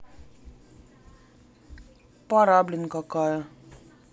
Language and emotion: Russian, sad